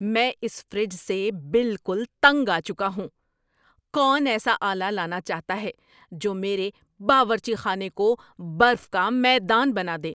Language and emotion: Urdu, angry